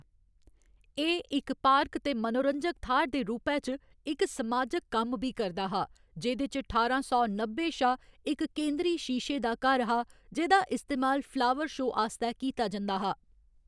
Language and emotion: Dogri, neutral